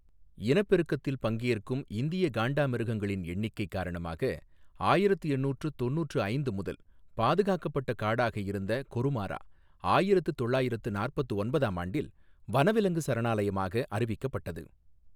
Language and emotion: Tamil, neutral